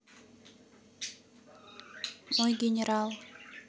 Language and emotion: Russian, neutral